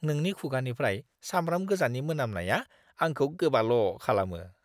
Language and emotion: Bodo, disgusted